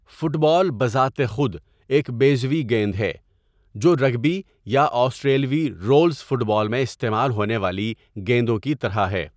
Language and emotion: Urdu, neutral